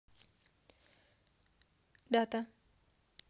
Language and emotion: Russian, neutral